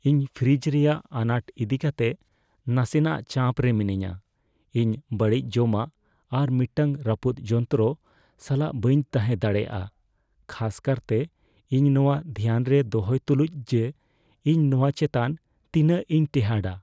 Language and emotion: Santali, fearful